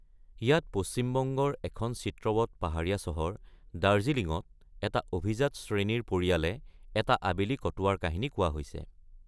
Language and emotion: Assamese, neutral